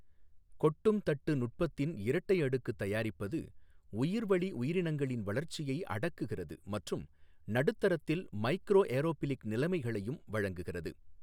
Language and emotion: Tamil, neutral